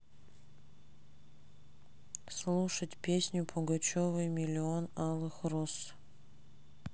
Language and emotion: Russian, sad